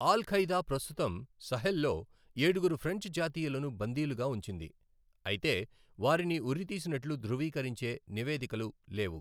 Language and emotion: Telugu, neutral